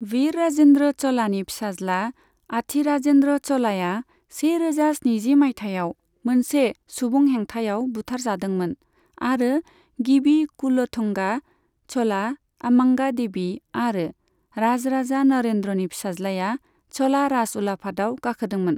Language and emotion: Bodo, neutral